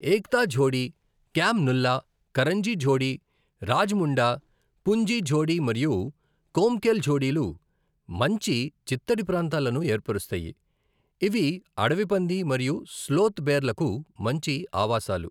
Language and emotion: Telugu, neutral